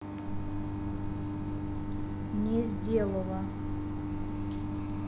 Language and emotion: Russian, neutral